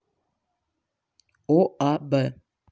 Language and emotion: Russian, neutral